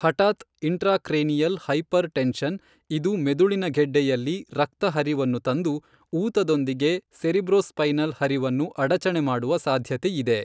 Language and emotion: Kannada, neutral